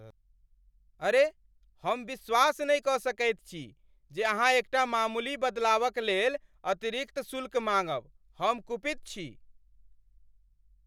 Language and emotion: Maithili, angry